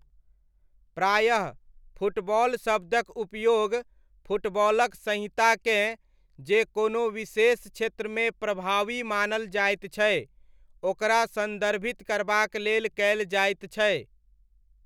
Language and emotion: Maithili, neutral